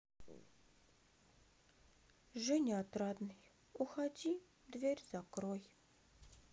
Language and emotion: Russian, sad